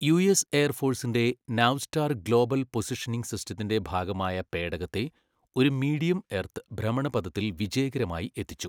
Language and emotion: Malayalam, neutral